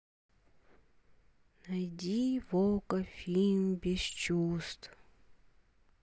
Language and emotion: Russian, sad